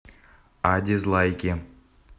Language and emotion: Russian, neutral